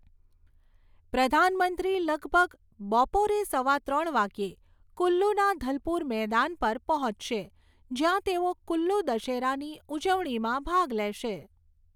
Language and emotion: Gujarati, neutral